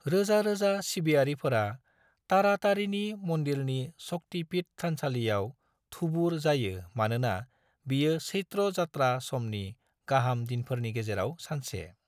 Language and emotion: Bodo, neutral